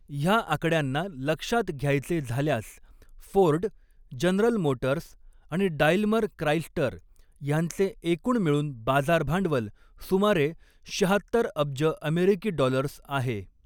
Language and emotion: Marathi, neutral